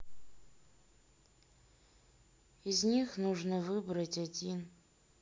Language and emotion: Russian, sad